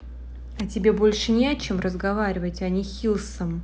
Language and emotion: Russian, neutral